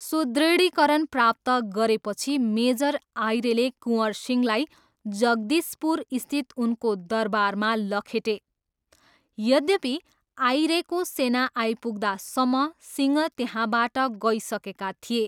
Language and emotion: Nepali, neutral